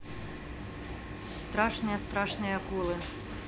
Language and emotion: Russian, neutral